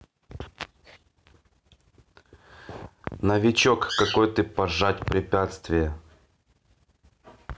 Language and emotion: Russian, neutral